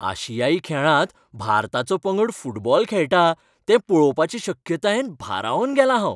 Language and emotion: Goan Konkani, happy